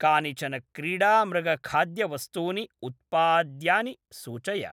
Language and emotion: Sanskrit, neutral